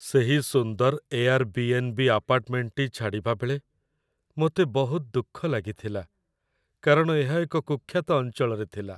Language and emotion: Odia, sad